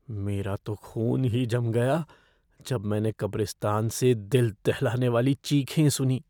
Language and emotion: Hindi, fearful